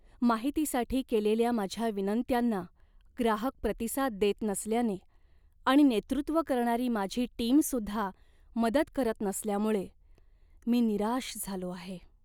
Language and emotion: Marathi, sad